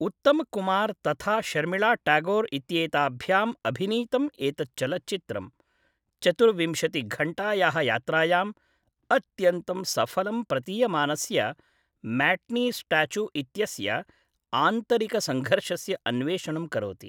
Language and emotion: Sanskrit, neutral